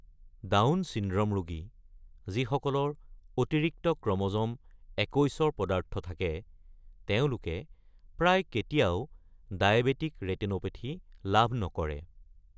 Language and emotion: Assamese, neutral